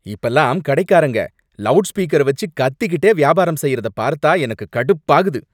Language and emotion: Tamil, angry